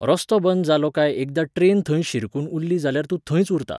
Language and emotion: Goan Konkani, neutral